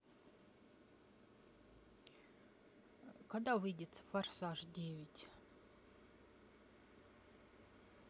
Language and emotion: Russian, neutral